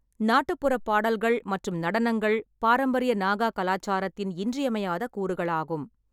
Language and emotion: Tamil, neutral